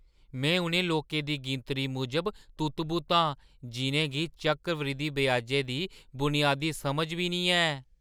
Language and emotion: Dogri, surprised